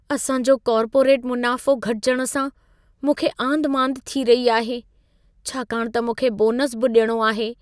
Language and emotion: Sindhi, fearful